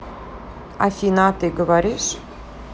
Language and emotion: Russian, neutral